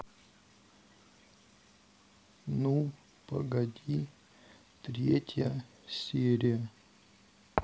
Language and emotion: Russian, sad